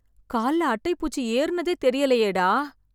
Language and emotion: Tamil, sad